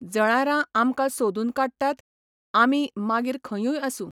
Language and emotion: Goan Konkani, neutral